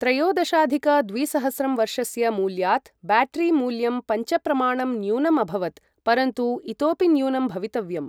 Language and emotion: Sanskrit, neutral